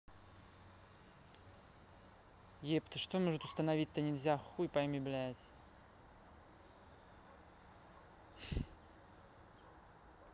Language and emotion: Russian, neutral